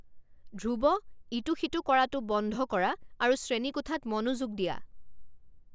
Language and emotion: Assamese, angry